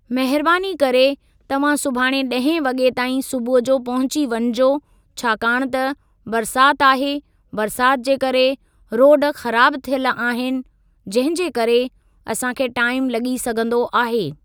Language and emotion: Sindhi, neutral